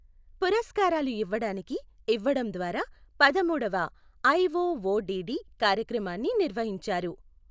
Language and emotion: Telugu, neutral